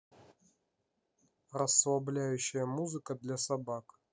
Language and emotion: Russian, neutral